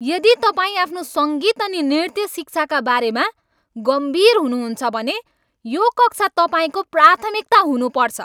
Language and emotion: Nepali, angry